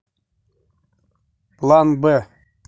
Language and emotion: Russian, neutral